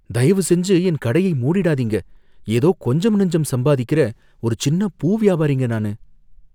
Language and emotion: Tamil, fearful